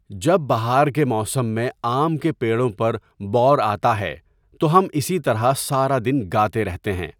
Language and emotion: Urdu, neutral